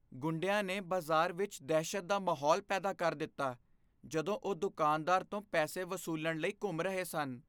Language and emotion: Punjabi, fearful